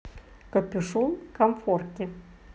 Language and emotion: Russian, neutral